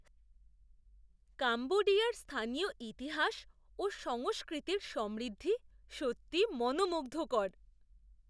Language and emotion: Bengali, surprised